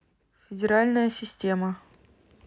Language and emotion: Russian, neutral